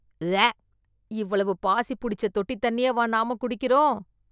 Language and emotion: Tamil, disgusted